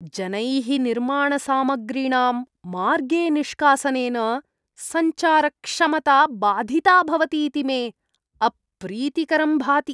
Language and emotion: Sanskrit, disgusted